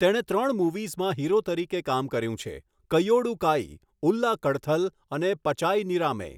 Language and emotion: Gujarati, neutral